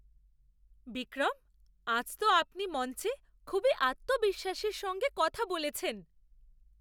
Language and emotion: Bengali, surprised